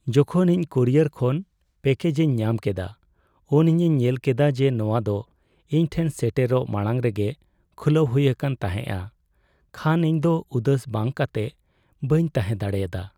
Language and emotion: Santali, sad